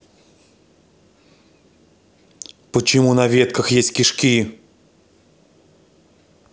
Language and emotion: Russian, angry